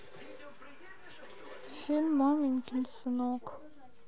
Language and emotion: Russian, sad